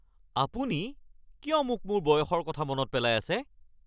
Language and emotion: Assamese, angry